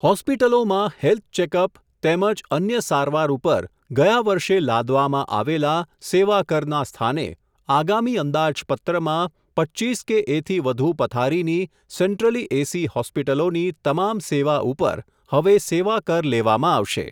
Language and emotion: Gujarati, neutral